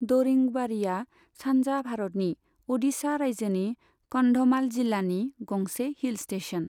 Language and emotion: Bodo, neutral